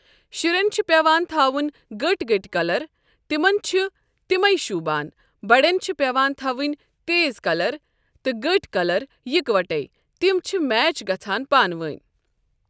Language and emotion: Kashmiri, neutral